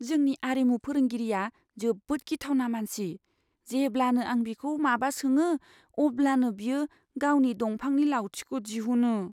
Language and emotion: Bodo, fearful